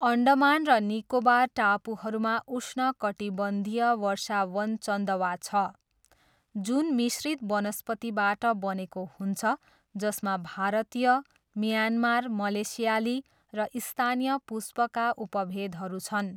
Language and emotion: Nepali, neutral